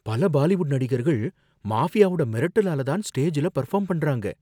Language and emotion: Tamil, fearful